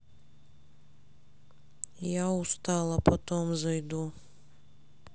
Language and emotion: Russian, sad